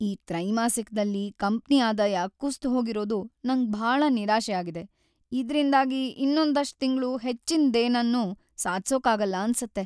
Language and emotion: Kannada, sad